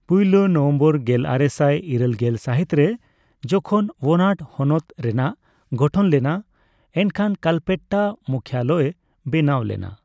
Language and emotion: Santali, neutral